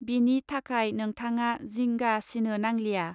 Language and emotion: Bodo, neutral